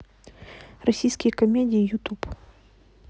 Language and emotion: Russian, neutral